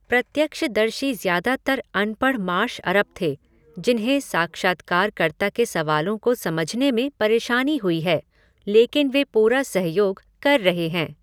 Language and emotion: Hindi, neutral